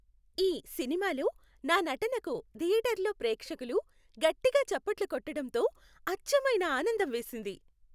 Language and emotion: Telugu, happy